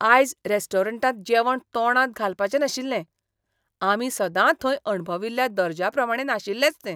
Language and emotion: Goan Konkani, disgusted